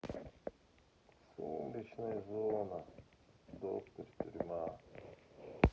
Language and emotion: Russian, sad